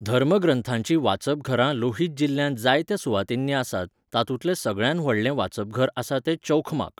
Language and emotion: Goan Konkani, neutral